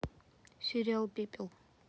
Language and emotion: Russian, neutral